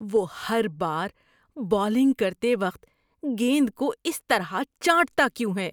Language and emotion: Urdu, disgusted